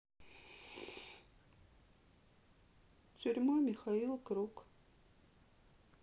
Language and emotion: Russian, sad